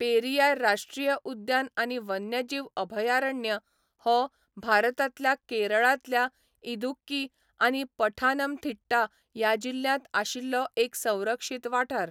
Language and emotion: Goan Konkani, neutral